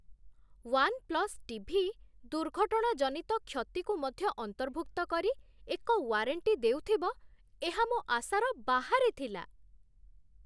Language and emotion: Odia, surprised